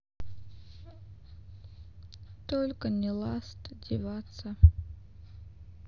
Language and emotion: Russian, sad